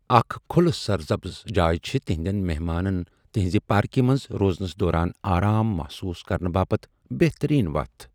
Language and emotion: Kashmiri, neutral